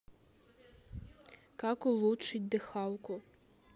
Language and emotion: Russian, neutral